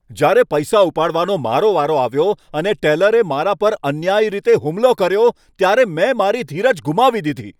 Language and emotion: Gujarati, angry